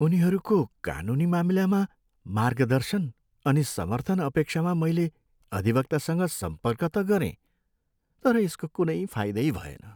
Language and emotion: Nepali, sad